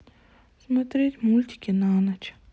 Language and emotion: Russian, sad